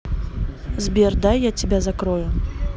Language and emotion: Russian, neutral